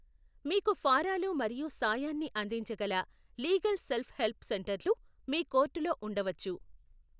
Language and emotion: Telugu, neutral